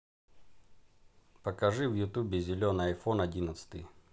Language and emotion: Russian, neutral